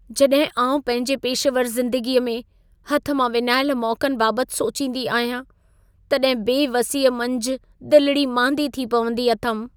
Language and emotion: Sindhi, sad